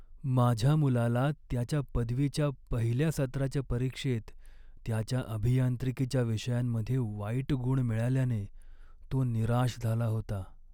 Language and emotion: Marathi, sad